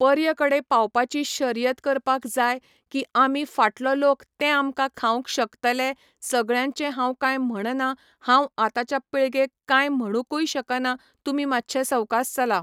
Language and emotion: Goan Konkani, neutral